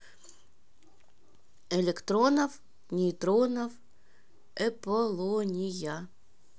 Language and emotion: Russian, neutral